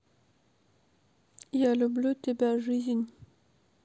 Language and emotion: Russian, neutral